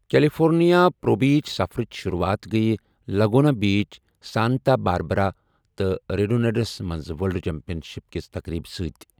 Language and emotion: Kashmiri, neutral